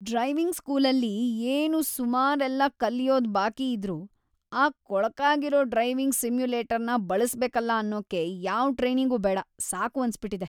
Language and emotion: Kannada, disgusted